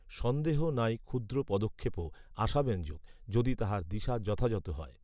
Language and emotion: Bengali, neutral